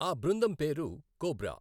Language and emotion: Telugu, neutral